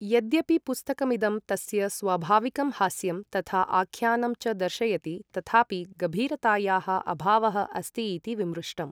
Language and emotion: Sanskrit, neutral